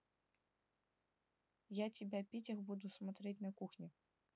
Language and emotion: Russian, neutral